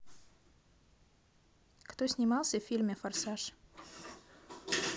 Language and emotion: Russian, neutral